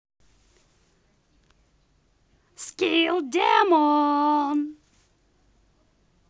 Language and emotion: Russian, angry